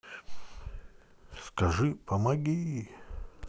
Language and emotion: Russian, neutral